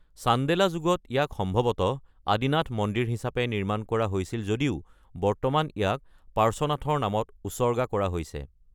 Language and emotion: Assamese, neutral